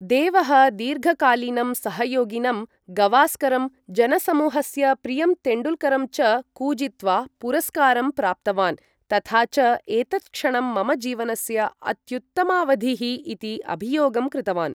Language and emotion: Sanskrit, neutral